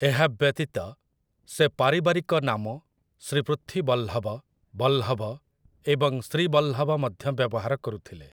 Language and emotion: Odia, neutral